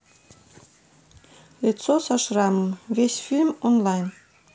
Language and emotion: Russian, neutral